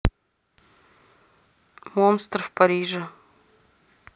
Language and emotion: Russian, neutral